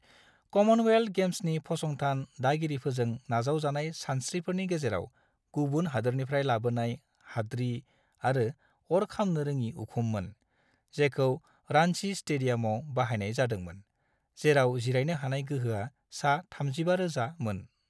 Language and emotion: Bodo, neutral